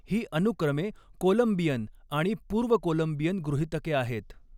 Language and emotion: Marathi, neutral